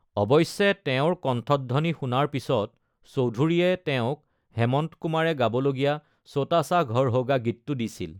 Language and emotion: Assamese, neutral